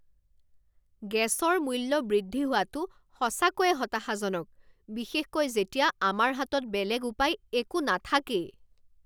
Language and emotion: Assamese, angry